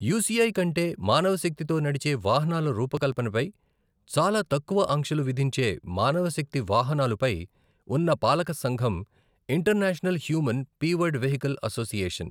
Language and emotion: Telugu, neutral